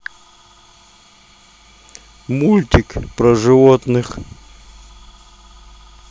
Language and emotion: Russian, neutral